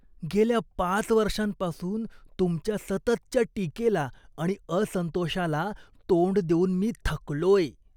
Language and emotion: Marathi, disgusted